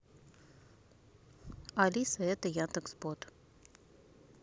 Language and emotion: Russian, neutral